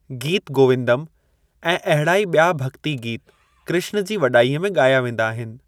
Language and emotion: Sindhi, neutral